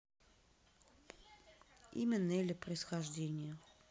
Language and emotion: Russian, neutral